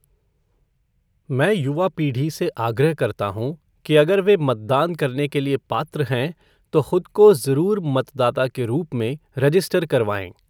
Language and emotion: Hindi, neutral